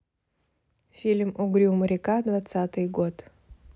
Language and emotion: Russian, neutral